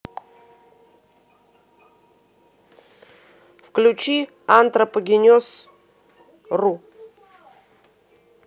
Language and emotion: Russian, neutral